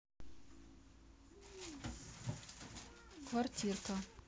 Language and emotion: Russian, neutral